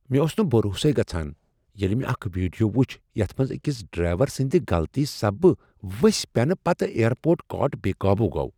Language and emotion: Kashmiri, surprised